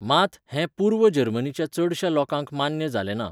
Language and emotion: Goan Konkani, neutral